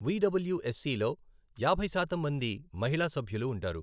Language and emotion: Telugu, neutral